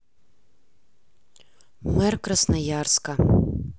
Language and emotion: Russian, neutral